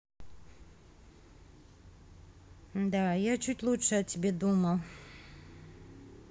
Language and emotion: Russian, neutral